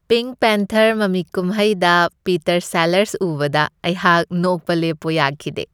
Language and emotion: Manipuri, happy